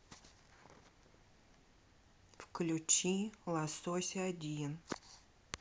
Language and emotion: Russian, neutral